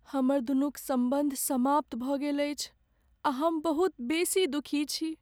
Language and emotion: Maithili, sad